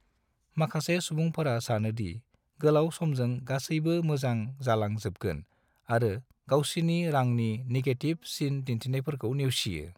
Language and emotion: Bodo, neutral